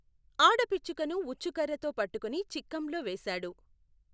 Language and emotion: Telugu, neutral